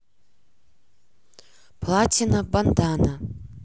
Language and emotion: Russian, neutral